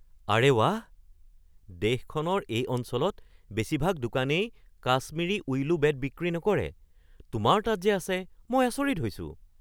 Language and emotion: Assamese, surprised